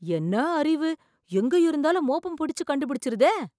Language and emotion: Tamil, surprised